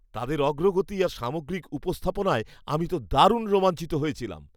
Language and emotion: Bengali, happy